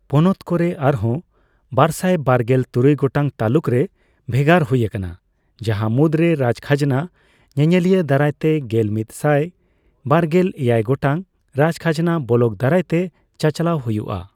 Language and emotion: Santali, neutral